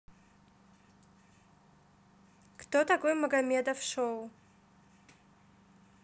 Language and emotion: Russian, neutral